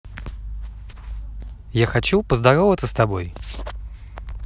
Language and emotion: Russian, neutral